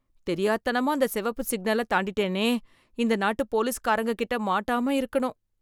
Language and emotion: Tamil, fearful